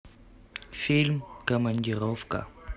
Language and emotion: Russian, neutral